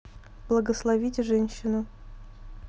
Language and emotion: Russian, neutral